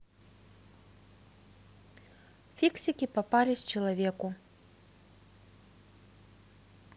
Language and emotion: Russian, neutral